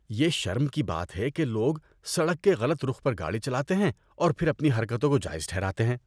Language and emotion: Urdu, disgusted